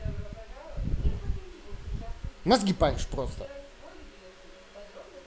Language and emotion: Russian, angry